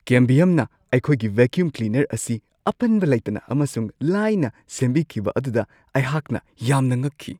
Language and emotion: Manipuri, surprised